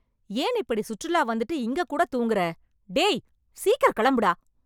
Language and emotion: Tamil, angry